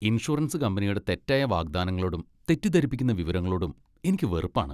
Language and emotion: Malayalam, disgusted